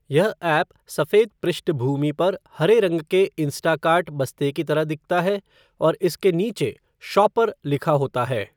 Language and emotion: Hindi, neutral